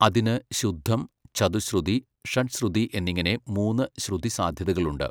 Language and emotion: Malayalam, neutral